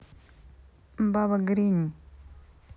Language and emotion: Russian, neutral